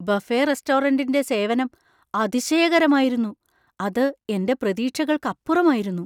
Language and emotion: Malayalam, surprised